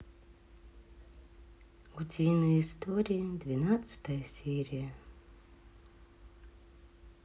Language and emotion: Russian, sad